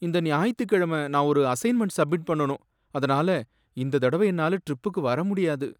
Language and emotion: Tamil, sad